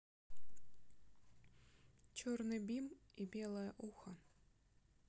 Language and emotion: Russian, neutral